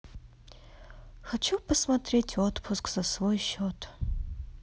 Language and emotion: Russian, sad